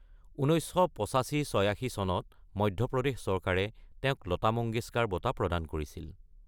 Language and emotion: Assamese, neutral